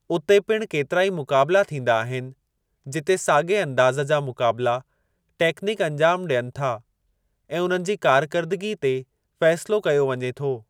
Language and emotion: Sindhi, neutral